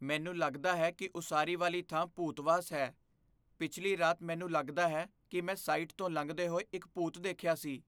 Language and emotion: Punjabi, fearful